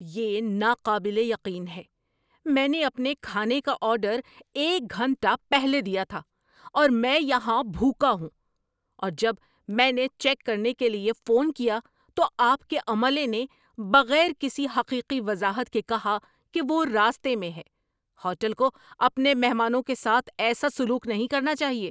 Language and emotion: Urdu, angry